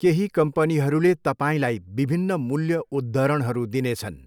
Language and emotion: Nepali, neutral